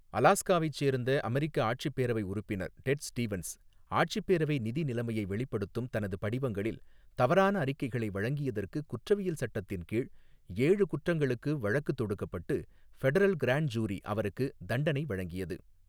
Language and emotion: Tamil, neutral